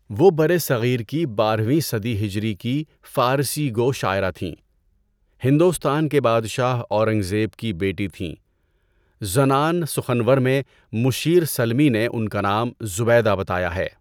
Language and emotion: Urdu, neutral